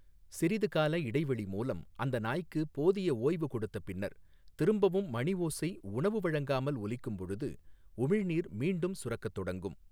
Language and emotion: Tamil, neutral